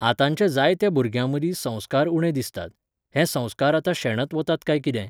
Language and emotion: Goan Konkani, neutral